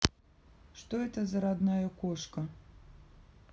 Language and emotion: Russian, neutral